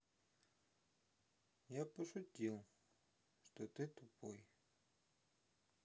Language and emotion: Russian, sad